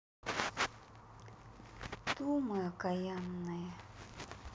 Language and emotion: Russian, sad